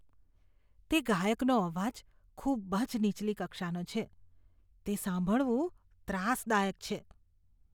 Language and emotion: Gujarati, disgusted